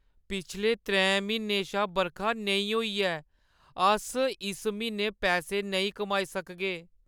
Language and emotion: Dogri, sad